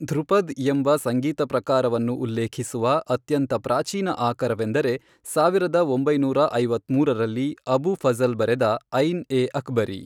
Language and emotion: Kannada, neutral